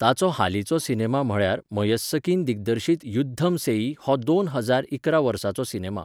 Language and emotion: Goan Konkani, neutral